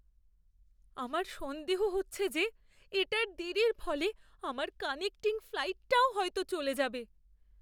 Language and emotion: Bengali, fearful